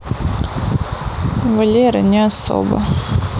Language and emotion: Russian, neutral